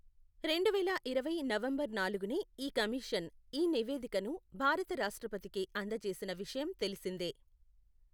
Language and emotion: Telugu, neutral